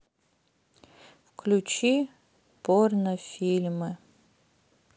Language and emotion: Russian, sad